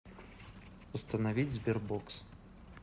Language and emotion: Russian, neutral